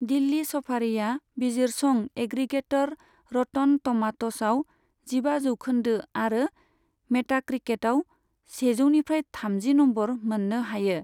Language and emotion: Bodo, neutral